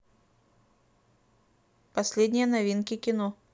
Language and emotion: Russian, neutral